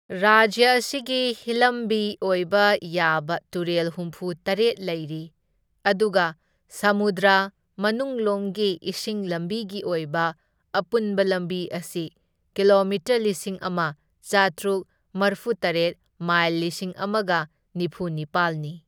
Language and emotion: Manipuri, neutral